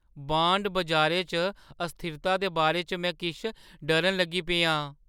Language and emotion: Dogri, fearful